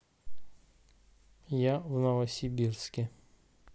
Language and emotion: Russian, neutral